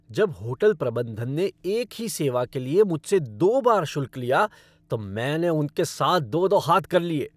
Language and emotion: Hindi, angry